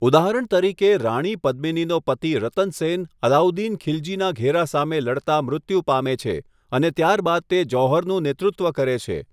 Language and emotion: Gujarati, neutral